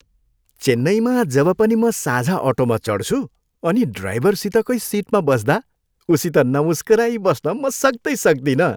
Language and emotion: Nepali, happy